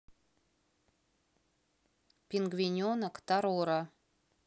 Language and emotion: Russian, neutral